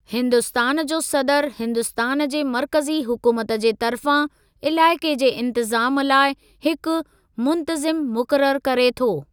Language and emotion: Sindhi, neutral